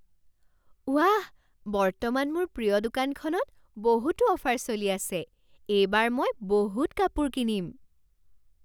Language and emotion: Assamese, surprised